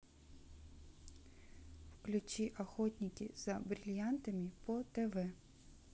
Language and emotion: Russian, neutral